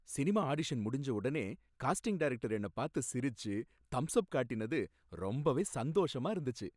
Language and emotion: Tamil, happy